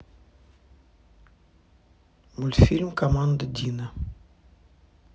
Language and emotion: Russian, neutral